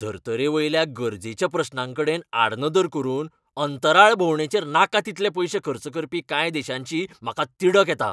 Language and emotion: Goan Konkani, angry